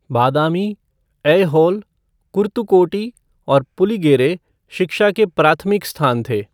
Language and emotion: Hindi, neutral